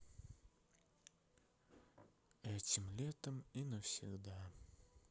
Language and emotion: Russian, sad